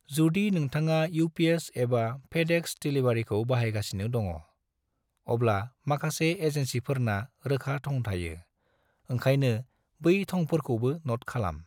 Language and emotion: Bodo, neutral